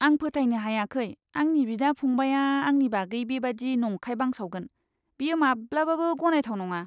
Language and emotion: Bodo, disgusted